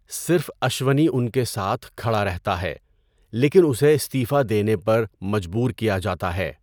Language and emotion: Urdu, neutral